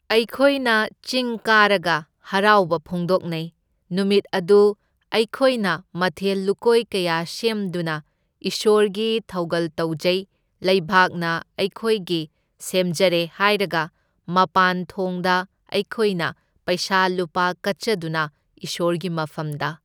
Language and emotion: Manipuri, neutral